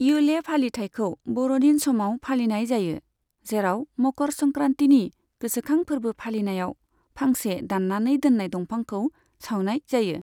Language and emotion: Bodo, neutral